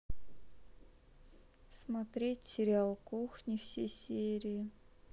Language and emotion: Russian, sad